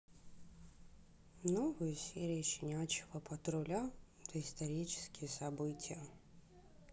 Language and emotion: Russian, sad